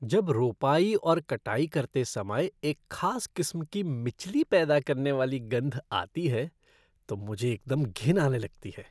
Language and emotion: Hindi, disgusted